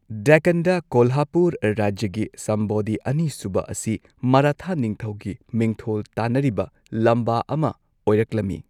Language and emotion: Manipuri, neutral